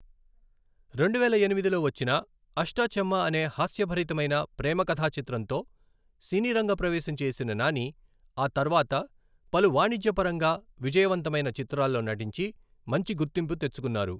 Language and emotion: Telugu, neutral